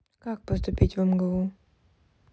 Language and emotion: Russian, neutral